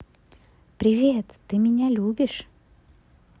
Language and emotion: Russian, positive